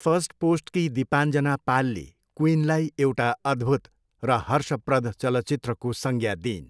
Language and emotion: Nepali, neutral